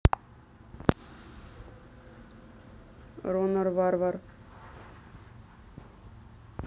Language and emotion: Russian, neutral